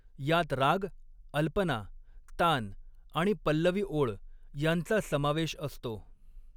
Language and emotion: Marathi, neutral